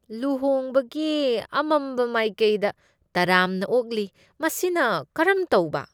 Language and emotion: Manipuri, disgusted